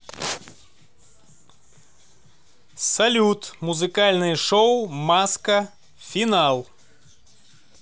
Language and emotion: Russian, positive